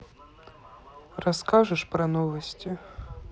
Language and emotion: Russian, sad